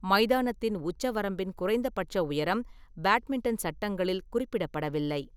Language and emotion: Tamil, neutral